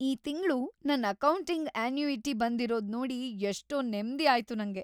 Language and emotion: Kannada, happy